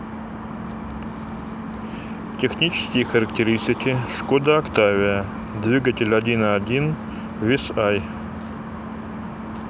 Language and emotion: Russian, neutral